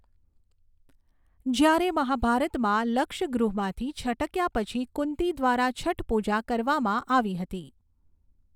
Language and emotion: Gujarati, neutral